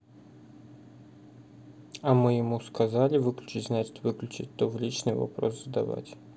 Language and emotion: Russian, neutral